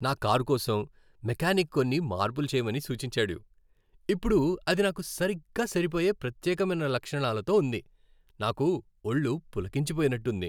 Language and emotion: Telugu, happy